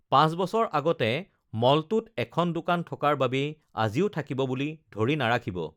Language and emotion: Assamese, neutral